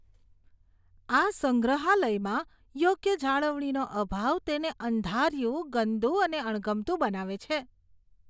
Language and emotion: Gujarati, disgusted